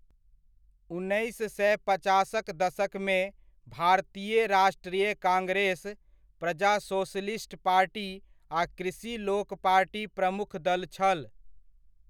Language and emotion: Maithili, neutral